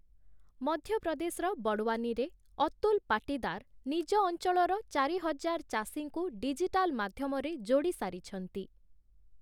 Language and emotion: Odia, neutral